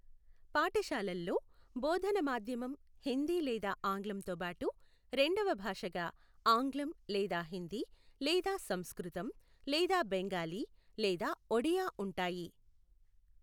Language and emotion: Telugu, neutral